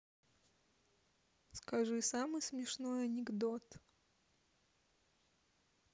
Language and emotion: Russian, neutral